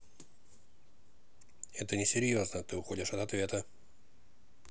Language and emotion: Russian, neutral